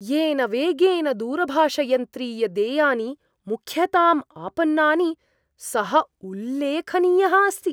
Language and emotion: Sanskrit, surprised